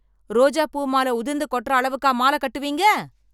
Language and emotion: Tamil, angry